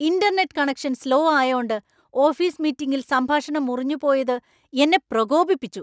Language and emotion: Malayalam, angry